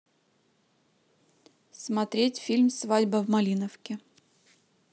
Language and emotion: Russian, neutral